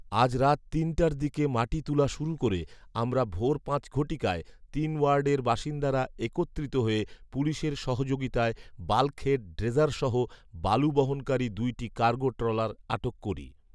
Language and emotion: Bengali, neutral